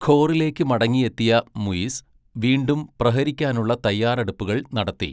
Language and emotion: Malayalam, neutral